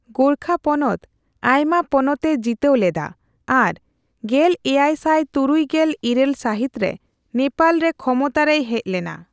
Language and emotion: Santali, neutral